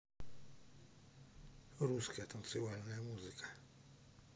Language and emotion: Russian, neutral